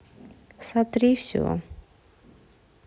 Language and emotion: Russian, neutral